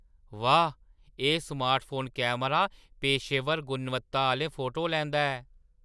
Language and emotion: Dogri, surprised